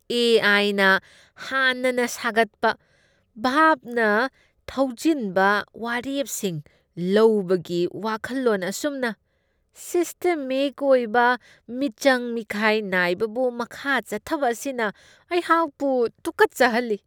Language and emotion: Manipuri, disgusted